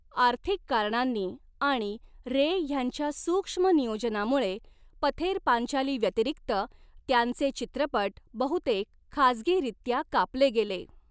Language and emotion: Marathi, neutral